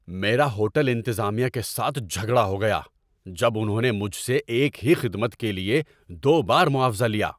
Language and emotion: Urdu, angry